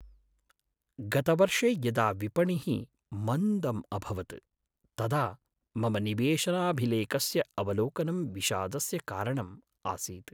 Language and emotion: Sanskrit, sad